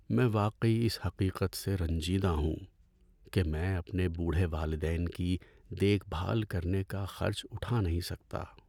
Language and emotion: Urdu, sad